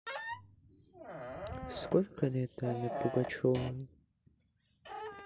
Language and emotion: Russian, sad